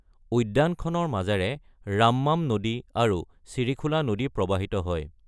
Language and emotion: Assamese, neutral